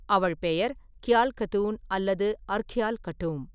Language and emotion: Tamil, neutral